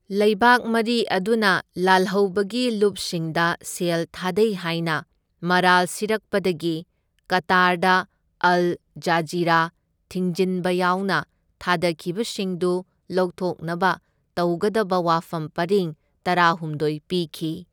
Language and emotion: Manipuri, neutral